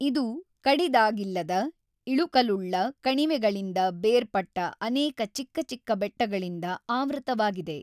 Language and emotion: Kannada, neutral